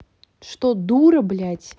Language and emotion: Russian, angry